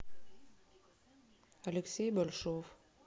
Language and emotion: Russian, neutral